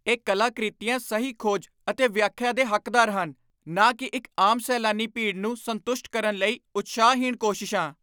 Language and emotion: Punjabi, angry